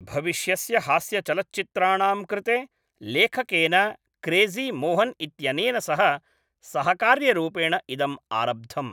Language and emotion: Sanskrit, neutral